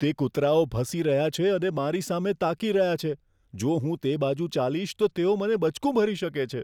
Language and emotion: Gujarati, fearful